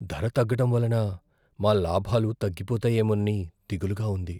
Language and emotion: Telugu, fearful